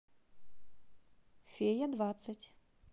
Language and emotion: Russian, neutral